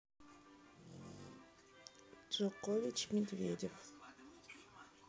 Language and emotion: Russian, neutral